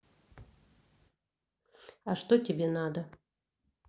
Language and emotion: Russian, neutral